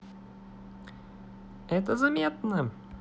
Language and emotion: Russian, positive